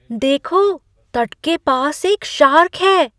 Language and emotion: Hindi, surprised